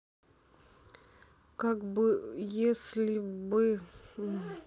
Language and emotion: Russian, neutral